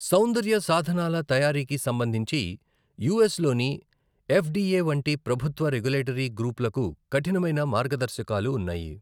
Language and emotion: Telugu, neutral